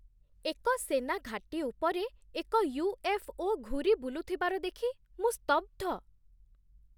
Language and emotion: Odia, surprised